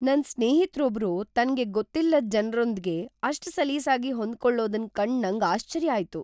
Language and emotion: Kannada, surprised